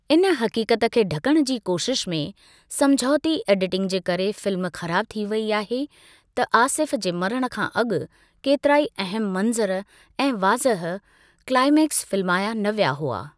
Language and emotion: Sindhi, neutral